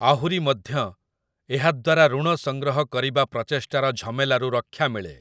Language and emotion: Odia, neutral